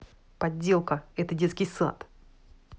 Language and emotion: Russian, angry